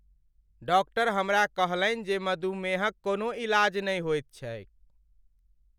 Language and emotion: Maithili, sad